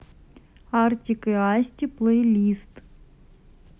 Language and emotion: Russian, neutral